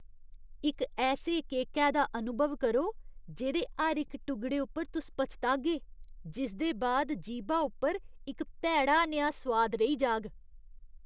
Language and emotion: Dogri, disgusted